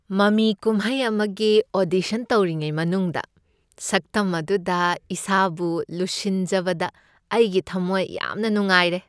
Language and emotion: Manipuri, happy